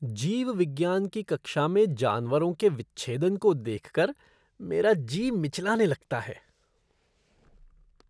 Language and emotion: Hindi, disgusted